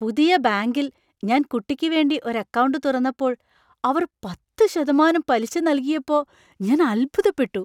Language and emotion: Malayalam, surprised